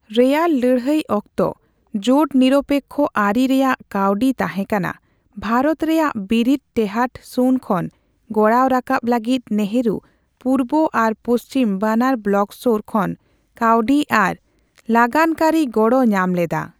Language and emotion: Santali, neutral